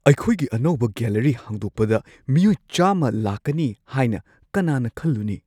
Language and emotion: Manipuri, surprised